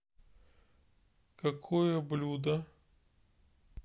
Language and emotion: Russian, neutral